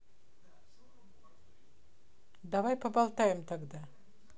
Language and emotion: Russian, neutral